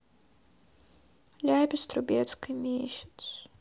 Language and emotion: Russian, sad